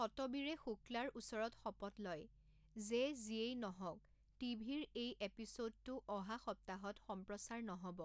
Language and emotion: Assamese, neutral